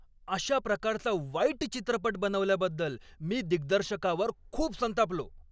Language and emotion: Marathi, angry